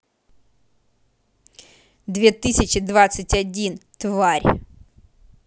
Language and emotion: Russian, angry